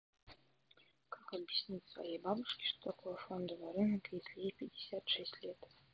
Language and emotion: Russian, neutral